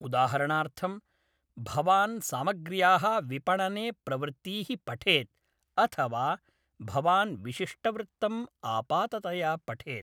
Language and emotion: Sanskrit, neutral